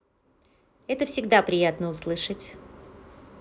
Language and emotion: Russian, positive